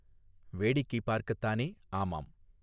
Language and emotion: Tamil, neutral